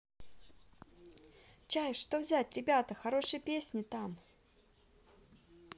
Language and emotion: Russian, positive